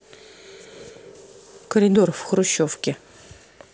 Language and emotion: Russian, neutral